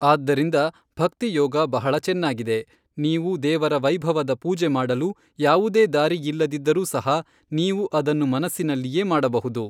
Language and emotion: Kannada, neutral